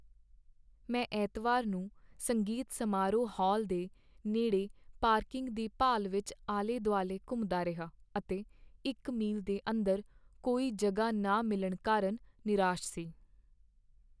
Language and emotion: Punjabi, sad